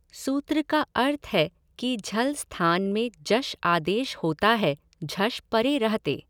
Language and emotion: Hindi, neutral